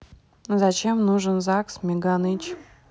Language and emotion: Russian, neutral